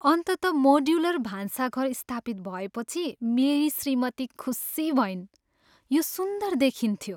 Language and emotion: Nepali, happy